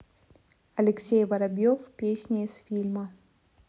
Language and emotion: Russian, neutral